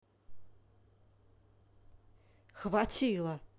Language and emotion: Russian, angry